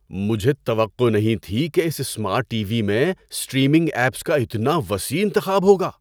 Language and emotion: Urdu, surprised